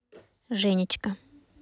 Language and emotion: Russian, neutral